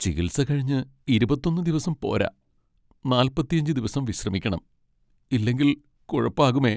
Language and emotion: Malayalam, sad